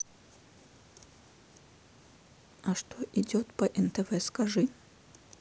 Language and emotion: Russian, neutral